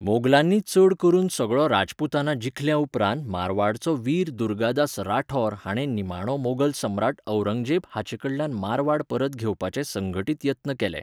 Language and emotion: Goan Konkani, neutral